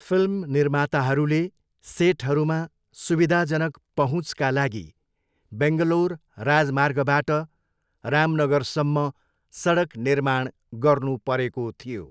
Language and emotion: Nepali, neutral